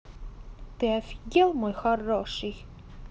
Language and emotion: Russian, angry